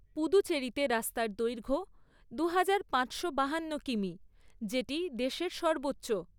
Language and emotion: Bengali, neutral